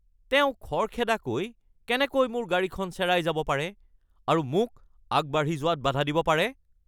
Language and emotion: Assamese, angry